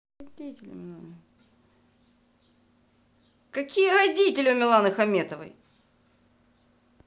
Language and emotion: Russian, angry